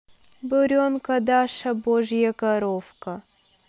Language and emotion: Russian, neutral